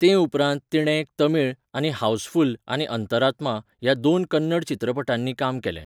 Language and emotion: Goan Konkani, neutral